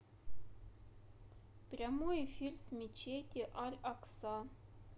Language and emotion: Russian, neutral